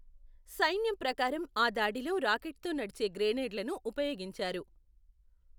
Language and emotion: Telugu, neutral